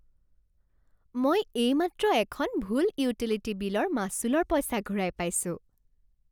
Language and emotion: Assamese, happy